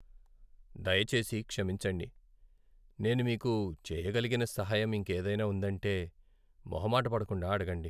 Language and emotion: Telugu, sad